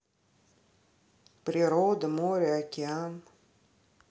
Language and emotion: Russian, neutral